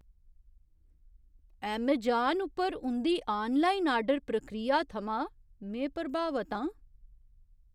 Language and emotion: Dogri, surprised